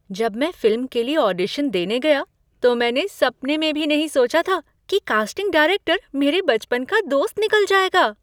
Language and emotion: Hindi, surprised